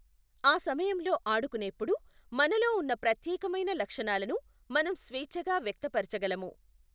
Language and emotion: Telugu, neutral